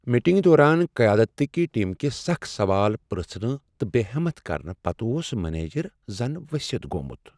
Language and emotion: Kashmiri, sad